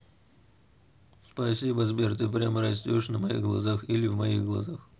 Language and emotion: Russian, neutral